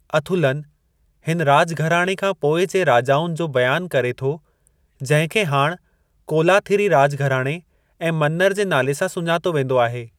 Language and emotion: Sindhi, neutral